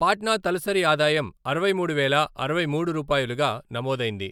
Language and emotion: Telugu, neutral